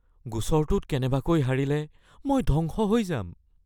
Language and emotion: Assamese, fearful